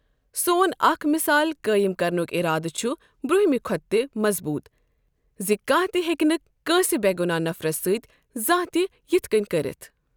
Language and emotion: Kashmiri, neutral